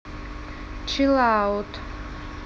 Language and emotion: Russian, neutral